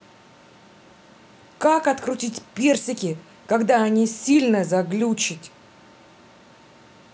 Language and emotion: Russian, angry